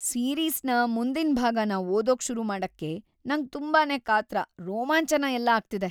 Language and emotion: Kannada, happy